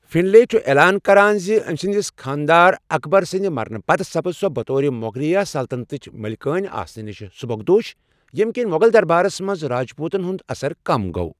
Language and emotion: Kashmiri, neutral